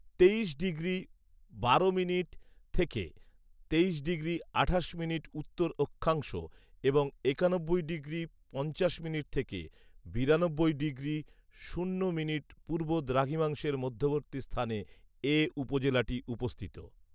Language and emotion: Bengali, neutral